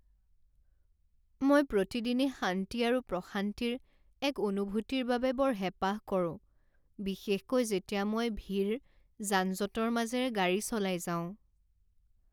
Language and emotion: Assamese, sad